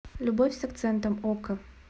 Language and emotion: Russian, neutral